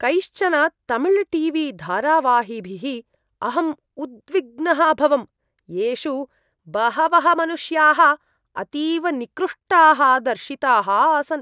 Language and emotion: Sanskrit, disgusted